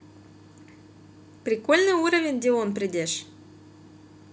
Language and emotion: Russian, positive